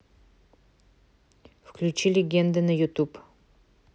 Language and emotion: Russian, neutral